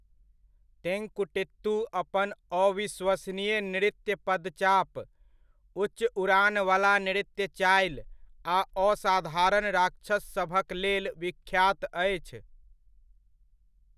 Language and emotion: Maithili, neutral